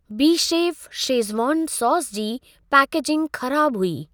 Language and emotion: Sindhi, neutral